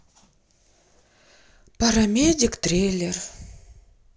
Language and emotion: Russian, sad